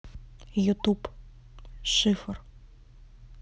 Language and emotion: Russian, neutral